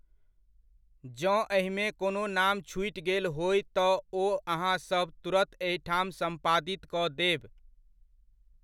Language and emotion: Maithili, neutral